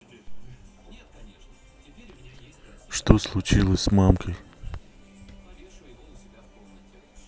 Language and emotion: Russian, neutral